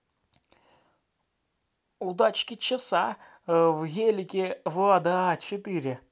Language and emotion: Russian, positive